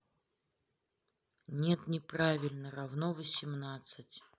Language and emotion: Russian, neutral